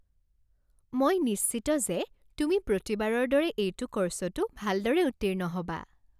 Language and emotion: Assamese, happy